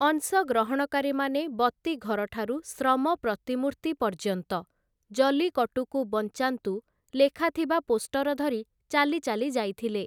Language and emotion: Odia, neutral